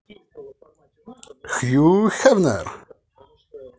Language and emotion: Russian, positive